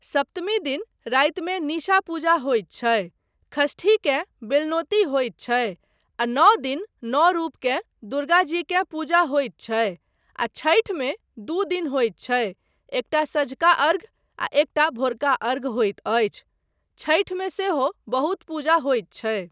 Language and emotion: Maithili, neutral